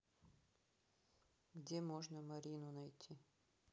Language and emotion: Russian, neutral